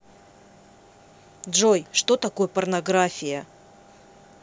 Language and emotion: Russian, angry